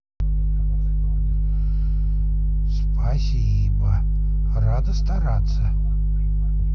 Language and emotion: Russian, positive